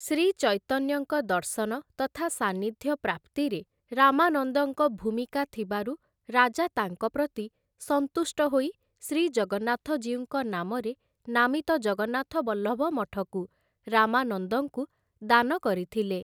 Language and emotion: Odia, neutral